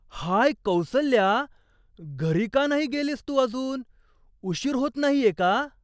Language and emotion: Marathi, surprised